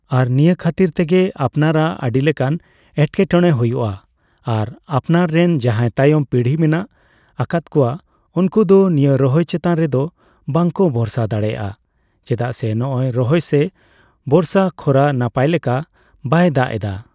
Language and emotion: Santali, neutral